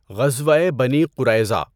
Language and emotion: Urdu, neutral